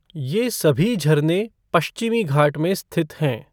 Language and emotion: Hindi, neutral